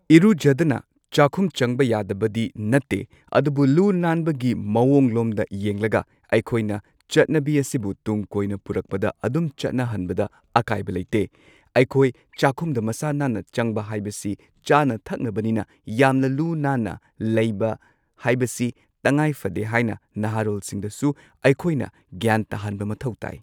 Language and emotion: Manipuri, neutral